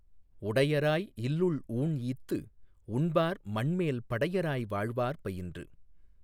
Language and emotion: Tamil, neutral